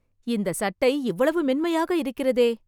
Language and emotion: Tamil, surprised